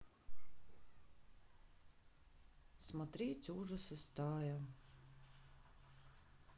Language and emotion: Russian, sad